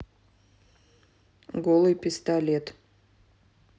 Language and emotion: Russian, neutral